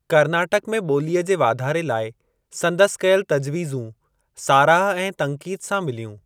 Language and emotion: Sindhi, neutral